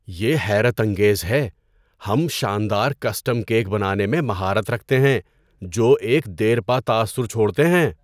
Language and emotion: Urdu, surprised